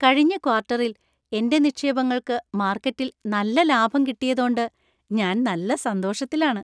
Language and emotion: Malayalam, happy